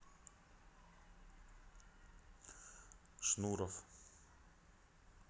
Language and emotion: Russian, neutral